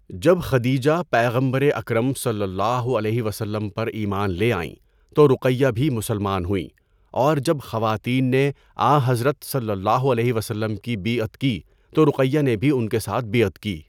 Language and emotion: Urdu, neutral